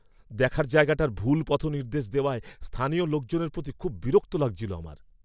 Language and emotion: Bengali, angry